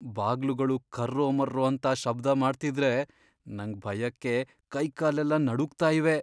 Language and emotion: Kannada, fearful